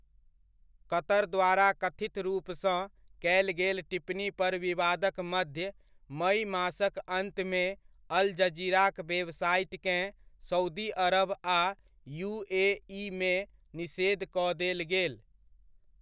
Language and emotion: Maithili, neutral